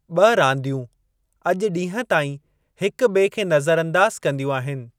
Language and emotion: Sindhi, neutral